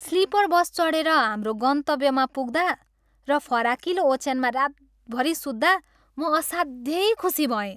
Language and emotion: Nepali, happy